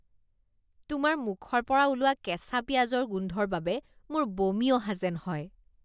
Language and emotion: Assamese, disgusted